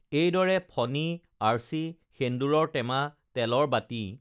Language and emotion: Assamese, neutral